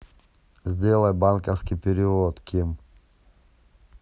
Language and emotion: Russian, neutral